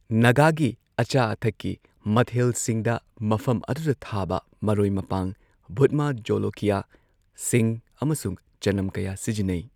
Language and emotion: Manipuri, neutral